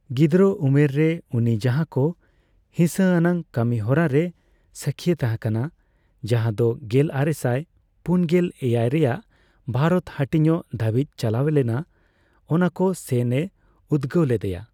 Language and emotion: Santali, neutral